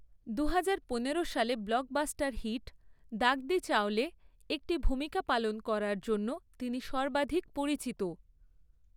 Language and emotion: Bengali, neutral